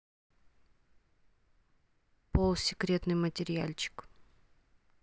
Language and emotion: Russian, neutral